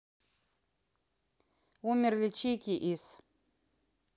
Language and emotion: Russian, neutral